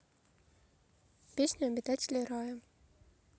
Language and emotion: Russian, neutral